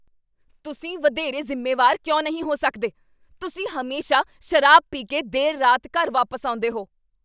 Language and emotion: Punjabi, angry